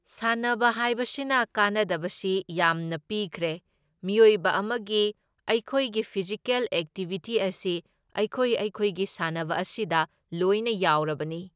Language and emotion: Manipuri, neutral